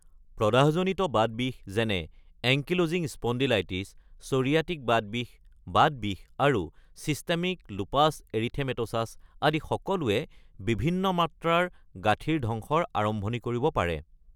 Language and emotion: Assamese, neutral